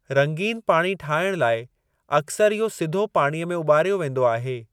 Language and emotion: Sindhi, neutral